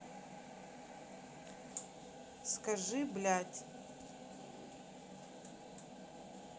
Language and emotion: Russian, neutral